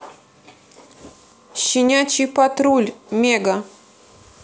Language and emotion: Russian, neutral